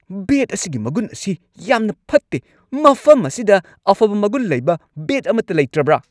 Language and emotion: Manipuri, angry